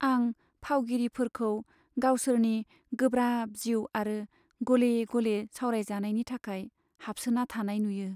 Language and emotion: Bodo, sad